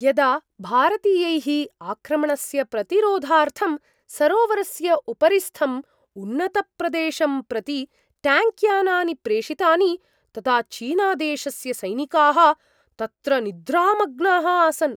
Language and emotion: Sanskrit, surprised